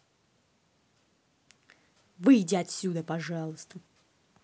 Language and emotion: Russian, angry